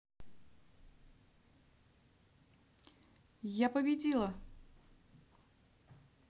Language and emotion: Russian, positive